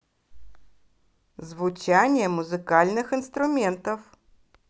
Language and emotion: Russian, positive